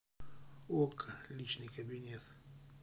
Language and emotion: Russian, neutral